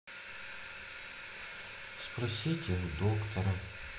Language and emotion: Russian, sad